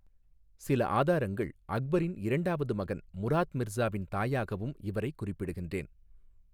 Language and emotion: Tamil, neutral